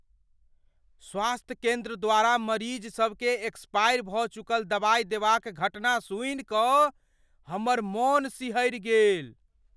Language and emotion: Maithili, fearful